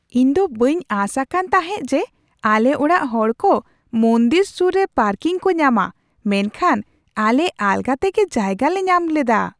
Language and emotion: Santali, surprised